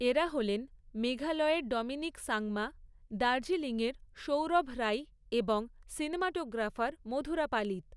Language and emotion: Bengali, neutral